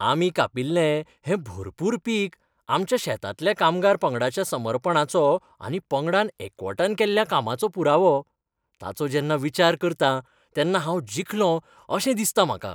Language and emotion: Goan Konkani, happy